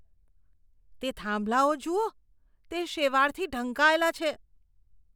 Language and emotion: Gujarati, disgusted